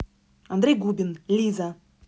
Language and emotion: Russian, neutral